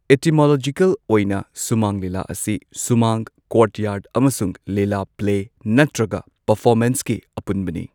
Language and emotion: Manipuri, neutral